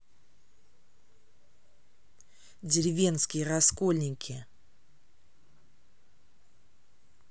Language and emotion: Russian, neutral